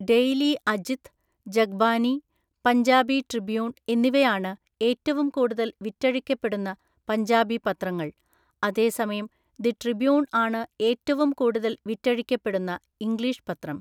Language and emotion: Malayalam, neutral